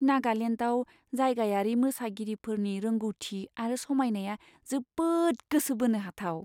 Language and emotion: Bodo, surprised